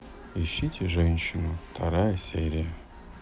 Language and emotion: Russian, sad